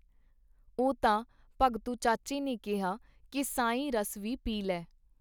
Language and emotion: Punjabi, neutral